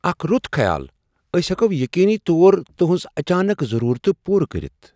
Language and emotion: Kashmiri, surprised